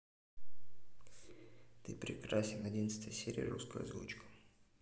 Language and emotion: Russian, neutral